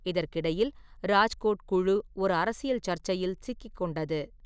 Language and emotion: Tamil, neutral